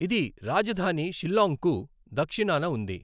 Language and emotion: Telugu, neutral